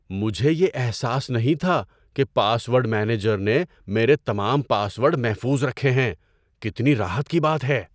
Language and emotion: Urdu, surprised